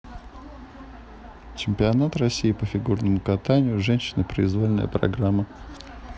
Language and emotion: Russian, neutral